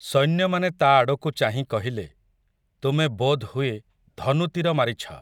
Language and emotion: Odia, neutral